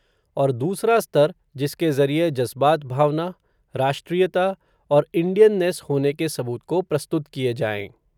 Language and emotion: Hindi, neutral